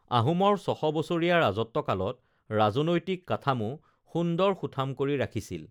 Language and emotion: Assamese, neutral